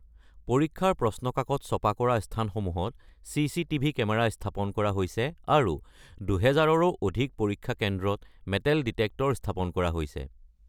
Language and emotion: Assamese, neutral